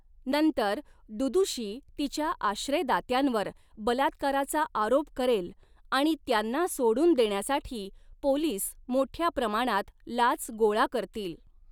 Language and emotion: Marathi, neutral